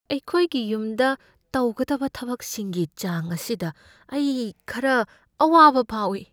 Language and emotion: Manipuri, fearful